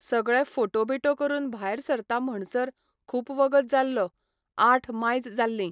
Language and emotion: Goan Konkani, neutral